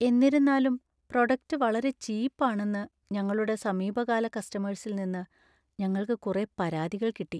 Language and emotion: Malayalam, sad